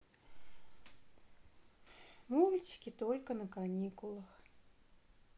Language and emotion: Russian, sad